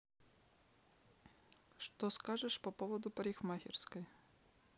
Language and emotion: Russian, neutral